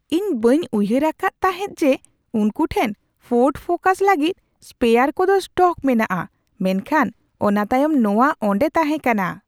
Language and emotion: Santali, surprised